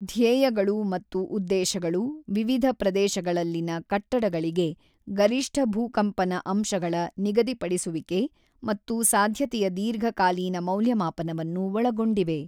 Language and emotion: Kannada, neutral